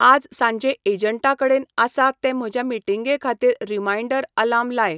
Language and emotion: Goan Konkani, neutral